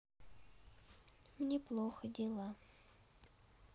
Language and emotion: Russian, sad